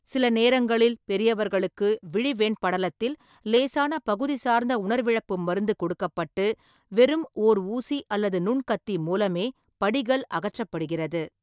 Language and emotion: Tamil, neutral